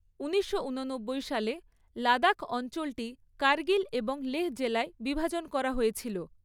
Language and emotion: Bengali, neutral